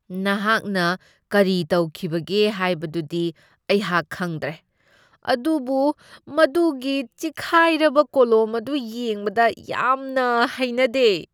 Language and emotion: Manipuri, disgusted